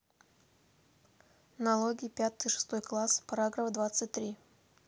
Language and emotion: Russian, neutral